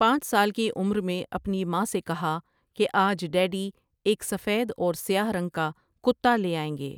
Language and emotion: Urdu, neutral